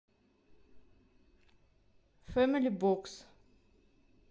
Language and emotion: Russian, neutral